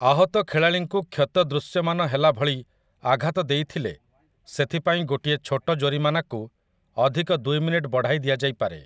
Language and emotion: Odia, neutral